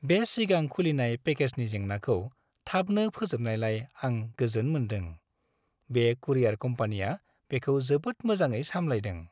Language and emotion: Bodo, happy